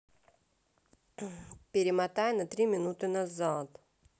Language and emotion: Russian, neutral